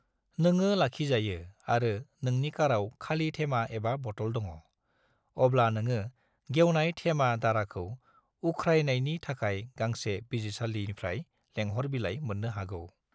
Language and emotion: Bodo, neutral